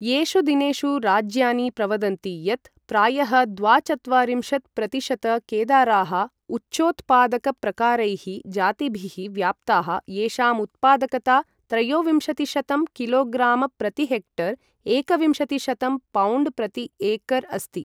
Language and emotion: Sanskrit, neutral